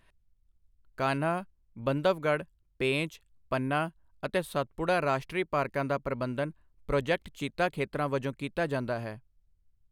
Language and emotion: Punjabi, neutral